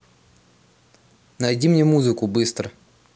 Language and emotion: Russian, angry